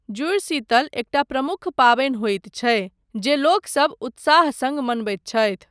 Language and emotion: Maithili, neutral